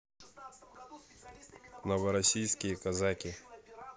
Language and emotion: Russian, neutral